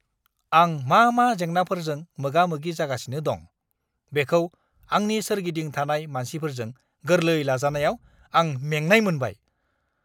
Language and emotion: Bodo, angry